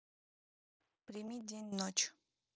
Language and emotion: Russian, neutral